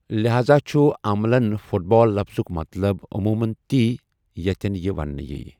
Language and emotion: Kashmiri, neutral